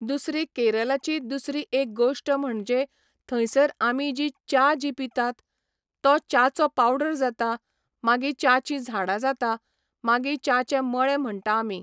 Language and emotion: Goan Konkani, neutral